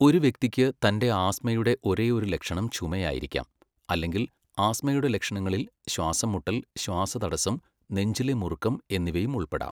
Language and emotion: Malayalam, neutral